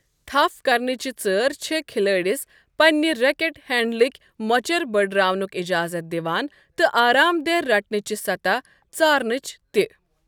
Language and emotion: Kashmiri, neutral